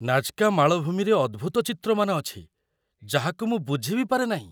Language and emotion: Odia, surprised